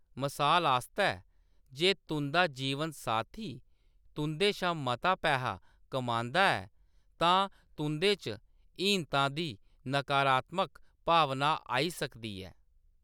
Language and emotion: Dogri, neutral